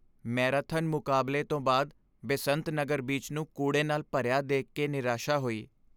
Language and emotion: Punjabi, sad